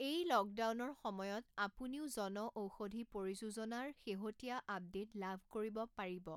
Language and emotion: Assamese, neutral